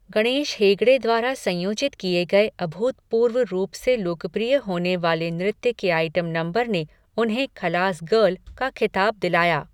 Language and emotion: Hindi, neutral